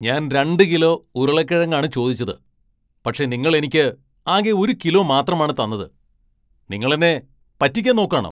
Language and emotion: Malayalam, angry